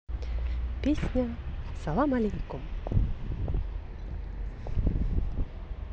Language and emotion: Russian, positive